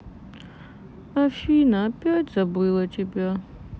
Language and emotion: Russian, sad